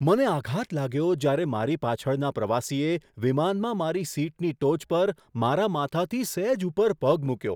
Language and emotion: Gujarati, surprised